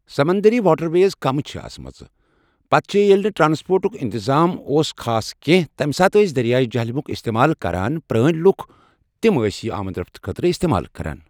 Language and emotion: Kashmiri, neutral